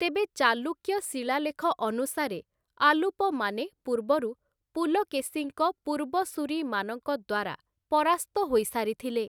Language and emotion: Odia, neutral